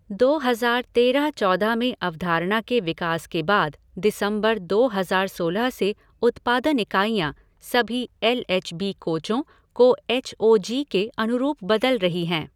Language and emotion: Hindi, neutral